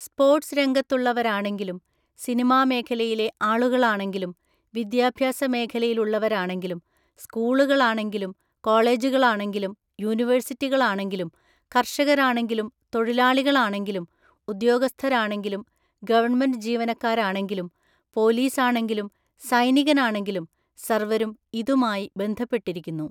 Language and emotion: Malayalam, neutral